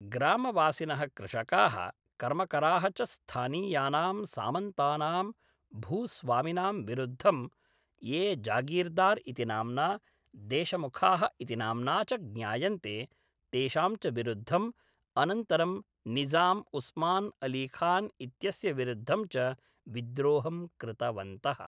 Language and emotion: Sanskrit, neutral